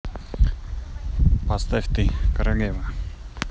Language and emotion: Russian, neutral